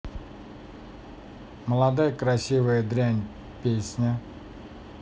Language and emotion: Russian, neutral